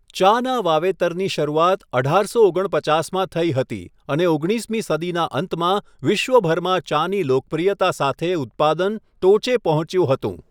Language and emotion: Gujarati, neutral